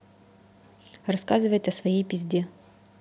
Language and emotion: Russian, neutral